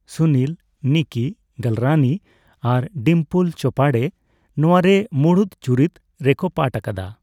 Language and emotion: Santali, neutral